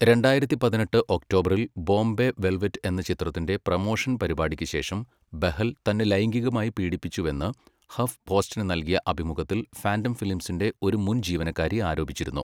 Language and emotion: Malayalam, neutral